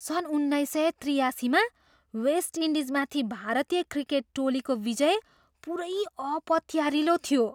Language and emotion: Nepali, surprised